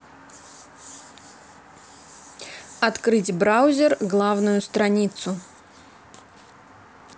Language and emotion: Russian, neutral